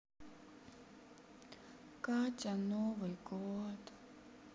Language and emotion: Russian, sad